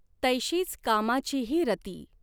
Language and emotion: Marathi, neutral